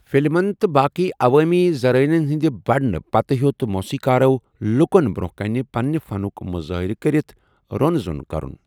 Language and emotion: Kashmiri, neutral